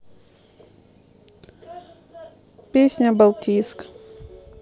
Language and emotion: Russian, neutral